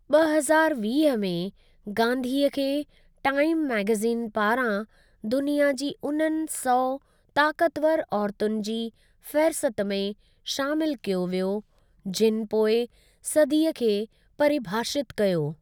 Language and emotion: Sindhi, neutral